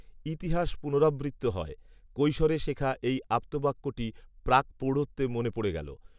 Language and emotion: Bengali, neutral